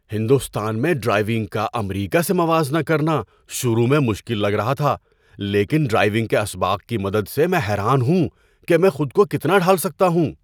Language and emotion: Urdu, surprised